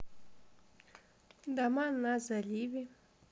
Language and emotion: Russian, neutral